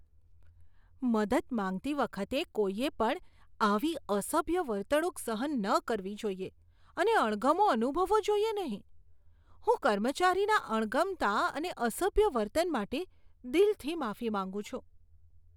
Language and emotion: Gujarati, disgusted